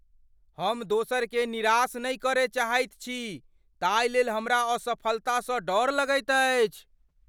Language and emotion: Maithili, fearful